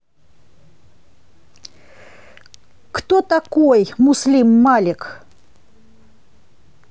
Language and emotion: Russian, angry